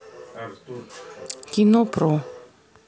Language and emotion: Russian, neutral